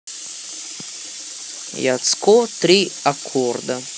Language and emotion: Russian, neutral